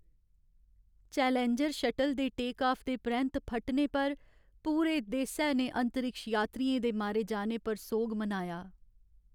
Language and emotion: Dogri, sad